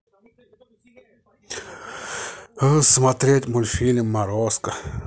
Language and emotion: Russian, positive